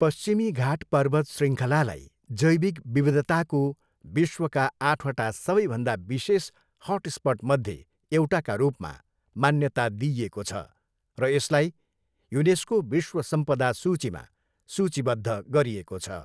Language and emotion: Nepali, neutral